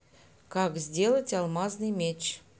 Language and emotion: Russian, neutral